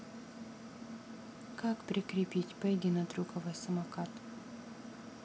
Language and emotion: Russian, neutral